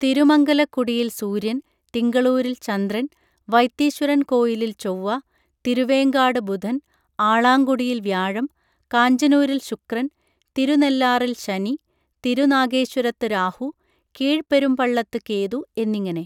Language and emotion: Malayalam, neutral